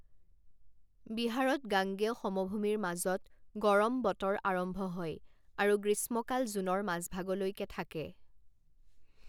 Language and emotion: Assamese, neutral